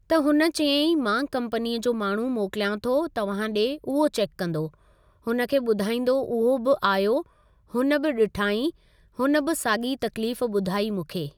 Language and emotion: Sindhi, neutral